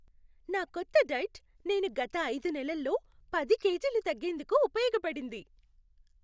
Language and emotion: Telugu, happy